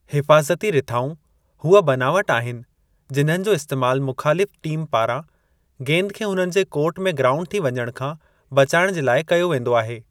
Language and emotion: Sindhi, neutral